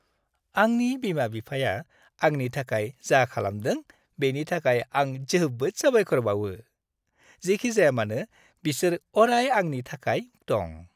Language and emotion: Bodo, happy